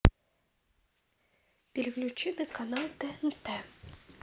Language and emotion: Russian, neutral